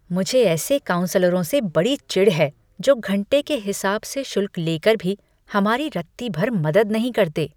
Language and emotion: Hindi, disgusted